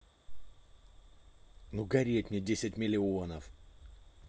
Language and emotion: Russian, angry